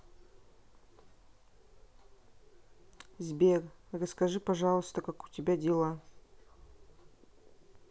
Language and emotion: Russian, neutral